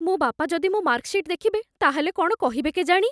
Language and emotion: Odia, fearful